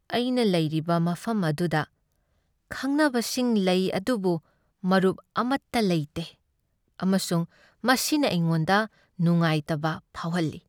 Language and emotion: Manipuri, sad